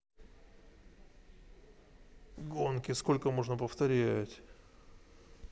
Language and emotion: Russian, angry